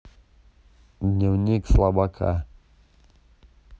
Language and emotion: Russian, neutral